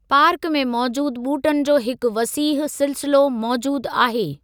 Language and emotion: Sindhi, neutral